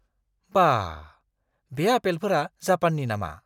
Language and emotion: Bodo, surprised